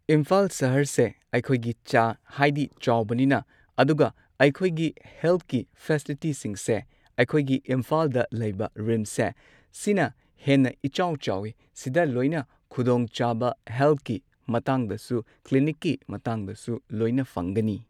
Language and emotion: Manipuri, neutral